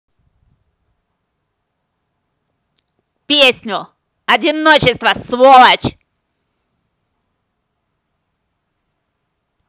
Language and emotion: Russian, angry